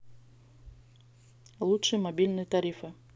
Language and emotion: Russian, neutral